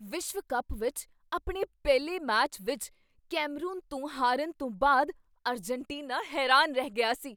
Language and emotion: Punjabi, surprised